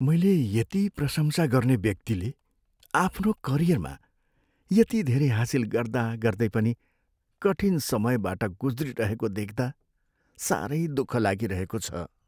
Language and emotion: Nepali, sad